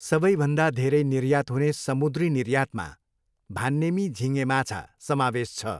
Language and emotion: Nepali, neutral